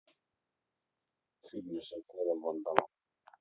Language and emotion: Russian, neutral